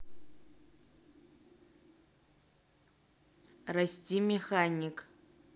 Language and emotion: Russian, neutral